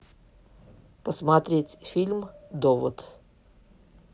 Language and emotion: Russian, neutral